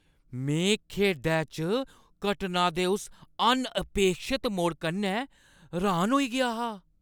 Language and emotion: Dogri, surprised